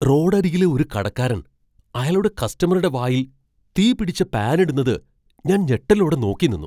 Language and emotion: Malayalam, surprised